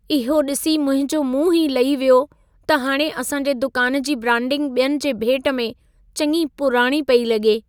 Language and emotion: Sindhi, sad